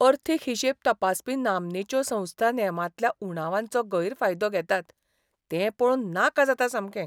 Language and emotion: Goan Konkani, disgusted